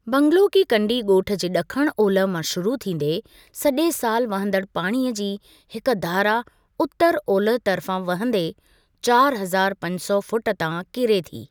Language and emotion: Sindhi, neutral